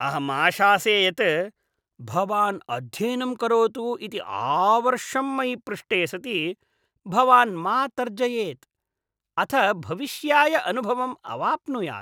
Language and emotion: Sanskrit, disgusted